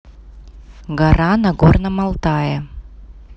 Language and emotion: Russian, neutral